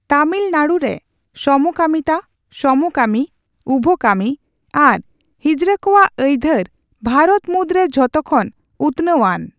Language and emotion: Santali, neutral